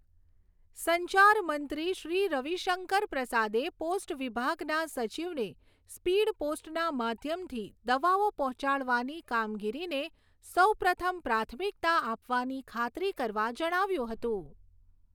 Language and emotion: Gujarati, neutral